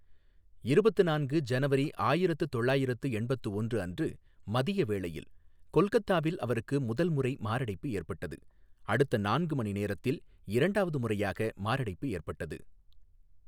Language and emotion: Tamil, neutral